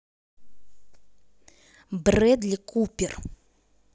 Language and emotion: Russian, angry